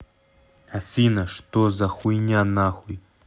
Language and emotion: Russian, angry